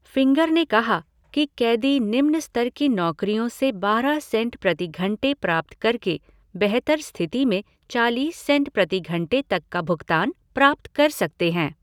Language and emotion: Hindi, neutral